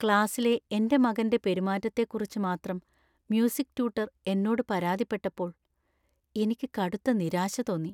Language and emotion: Malayalam, sad